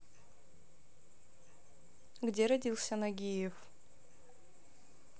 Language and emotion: Russian, neutral